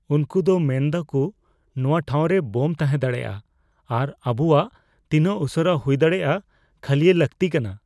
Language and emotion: Santali, fearful